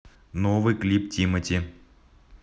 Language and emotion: Russian, neutral